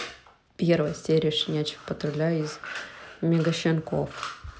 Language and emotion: Russian, neutral